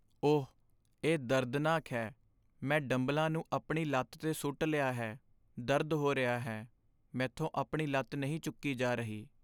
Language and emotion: Punjabi, sad